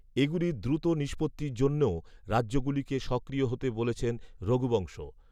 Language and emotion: Bengali, neutral